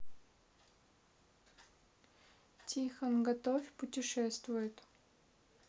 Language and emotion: Russian, neutral